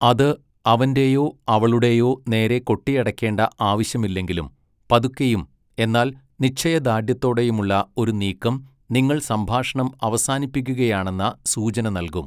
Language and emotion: Malayalam, neutral